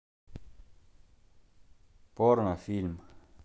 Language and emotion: Russian, neutral